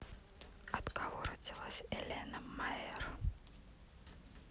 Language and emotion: Russian, neutral